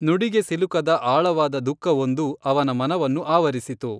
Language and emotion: Kannada, neutral